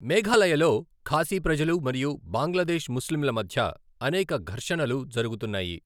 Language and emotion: Telugu, neutral